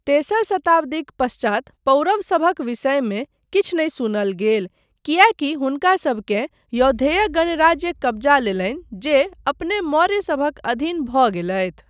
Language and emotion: Maithili, neutral